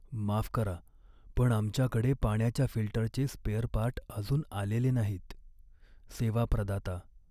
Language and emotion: Marathi, sad